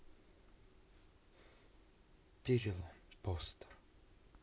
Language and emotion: Russian, neutral